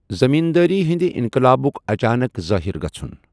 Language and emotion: Kashmiri, neutral